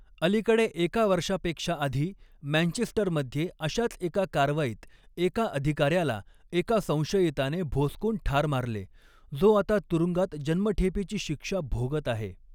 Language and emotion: Marathi, neutral